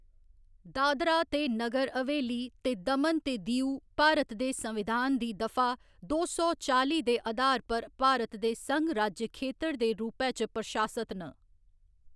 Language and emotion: Dogri, neutral